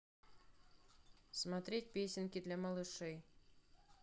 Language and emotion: Russian, neutral